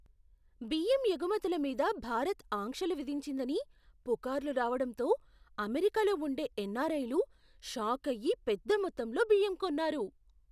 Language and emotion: Telugu, surprised